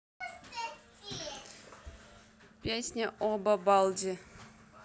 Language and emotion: Russian, neutral